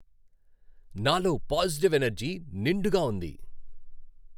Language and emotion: Telugu, happy